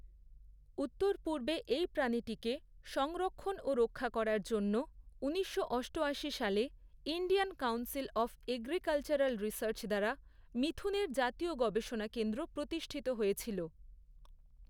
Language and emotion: Bengali, neutral